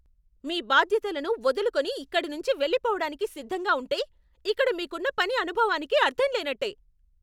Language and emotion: Telugu, angry